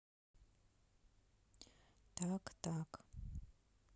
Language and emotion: Russian, neutral